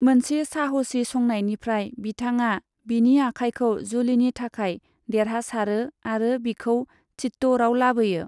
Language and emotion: Bodo, neutral